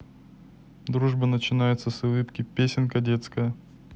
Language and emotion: Russian, neutral